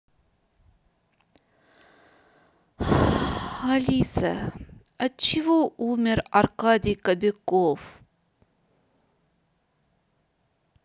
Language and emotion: Russian, sad